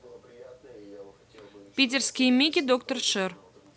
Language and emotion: Russian, neutral